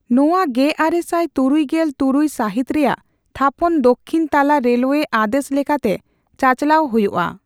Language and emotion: Santali, neutral